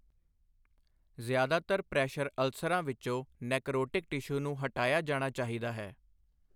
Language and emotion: Punjabi, neutral